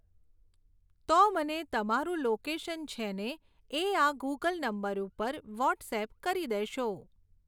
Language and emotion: Gujarati, neutral